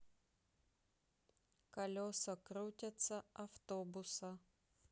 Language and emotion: Russian, neutral